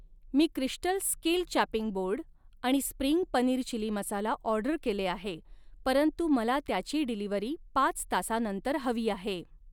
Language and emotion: Marathi, neutral